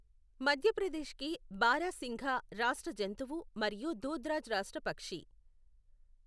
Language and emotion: Telugu, neutral